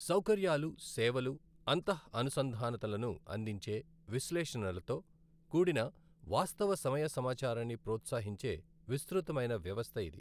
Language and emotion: Telugu, neutral